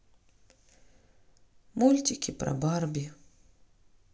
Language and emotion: Russian, sad